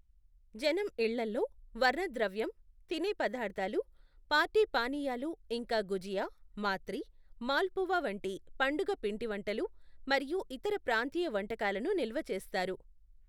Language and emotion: Telugu, neutral